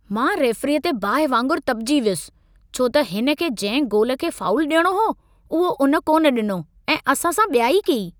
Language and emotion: Sindhi, angry